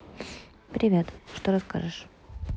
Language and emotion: Russian, neutral